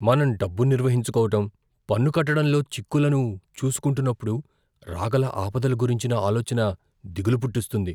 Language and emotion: Telugu, fearful